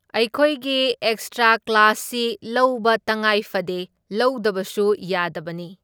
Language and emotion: Manipuri, neutral